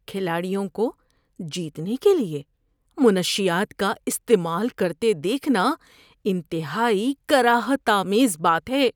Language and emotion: Urdu, disgusted